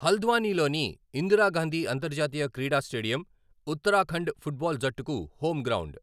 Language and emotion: Telugu, neutral